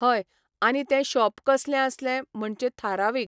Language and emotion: Goan Konkani, neutral